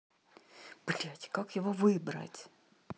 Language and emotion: Russian, angry